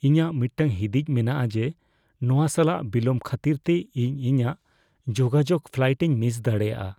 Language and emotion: Santali, fearful